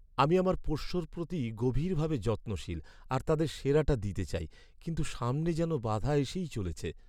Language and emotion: Bengali, sad